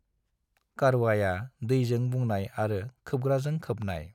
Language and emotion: Bodo, neutral